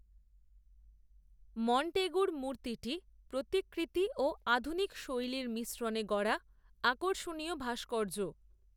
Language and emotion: Bengali, neutral